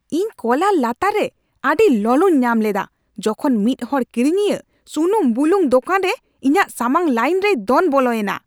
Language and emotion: Santali, angry